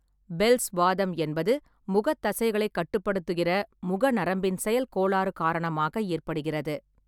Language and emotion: Tamil, neutral